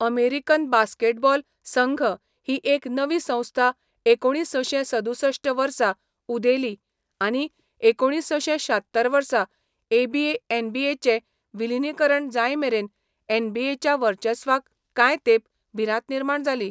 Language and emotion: Goan Konkani, neutral